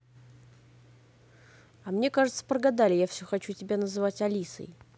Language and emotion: Russian, neutral